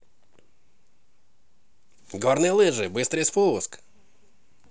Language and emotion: Russian, positive